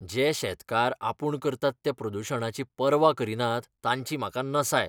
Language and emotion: Goan Konkani, disgusted